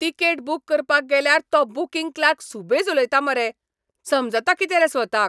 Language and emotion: Goan Konkani, angry